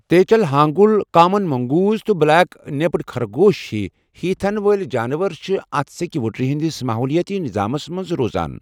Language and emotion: Kashmiri, neutral